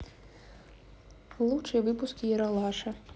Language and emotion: Russian, neutral